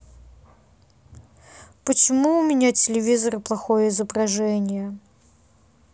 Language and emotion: Russian, sad